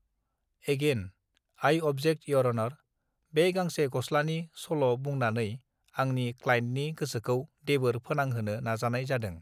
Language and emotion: Bodo, neutral